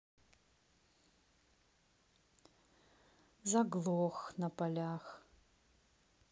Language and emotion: Russian, neutral